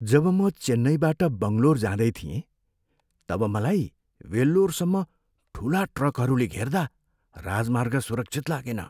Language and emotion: Nepali, fearful